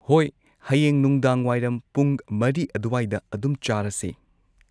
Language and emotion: Manipuri, neutral